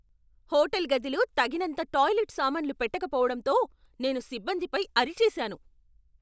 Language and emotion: Telugu, angry